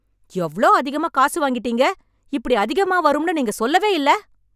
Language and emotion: Tamil, angry